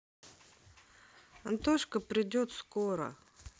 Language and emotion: Russian, neutral